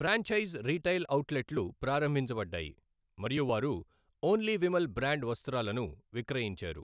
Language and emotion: Telugu, neutral